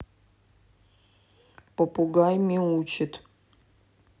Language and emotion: Russian, neutral